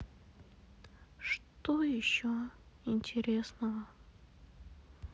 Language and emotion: Russian, sad